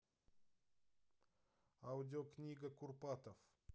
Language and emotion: Russian, neutral